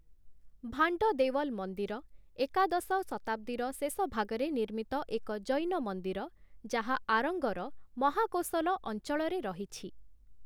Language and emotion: Odia, neutral